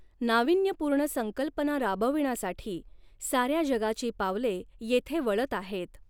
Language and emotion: Marathi, neutral